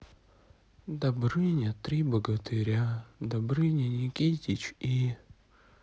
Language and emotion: Russian, sad